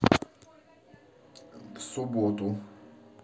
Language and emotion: Russian, neutral